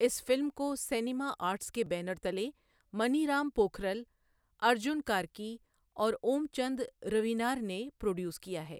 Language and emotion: Urdu, neutral